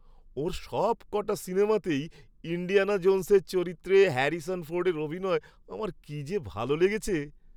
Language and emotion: Bengali, happy